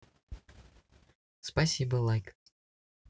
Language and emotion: Russian, positive